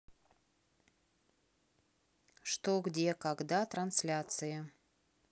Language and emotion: Russian, neutral